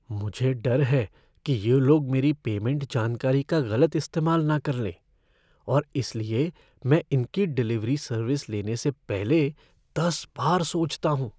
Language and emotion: Hindi, fearful